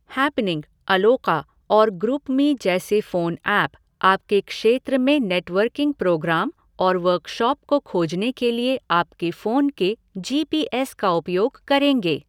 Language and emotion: Hindi, neutral